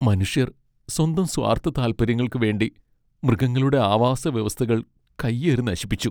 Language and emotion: Malayalam, sad